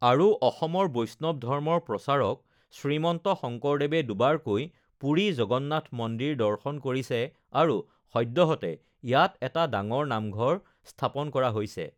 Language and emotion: Assamese, neutral